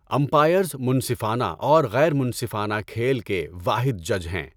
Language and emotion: Urdu, neutral